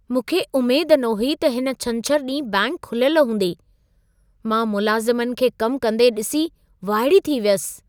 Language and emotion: Sindhi, surprised